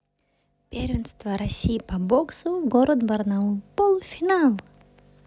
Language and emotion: Russian, positive